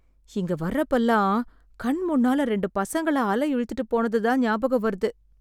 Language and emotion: Tamil, sad